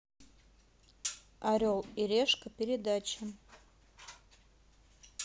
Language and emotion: Russian, neutral